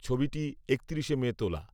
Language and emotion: Bengali, neutral